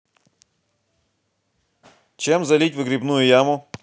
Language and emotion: Russian, positive